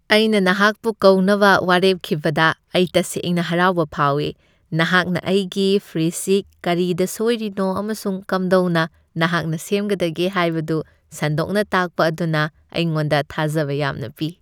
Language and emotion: Manipuri, happy